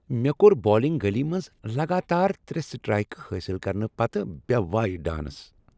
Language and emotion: Kashmiri, happy